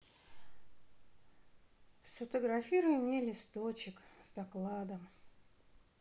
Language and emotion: Russian, sad